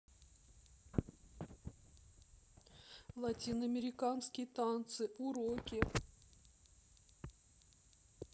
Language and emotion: Russian, sad